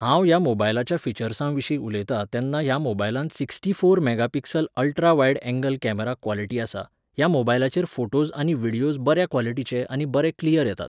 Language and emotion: Goan Konkani, neutral